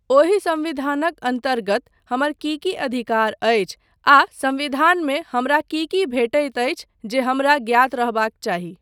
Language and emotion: Maithili, neutral